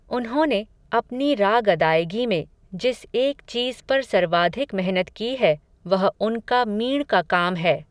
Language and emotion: Hindi, neutral